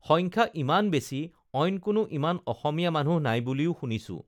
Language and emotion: Assamese, neutral